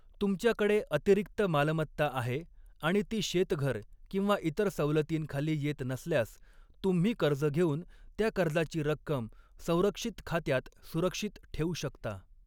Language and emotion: Marathi, neutral